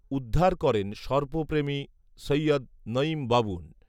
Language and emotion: Bengali, neutral